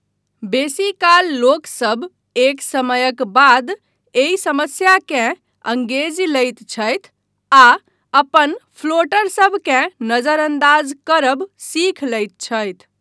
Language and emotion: Maithili, neutral